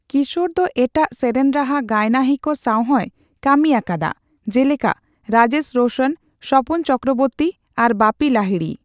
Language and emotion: Santali, neutral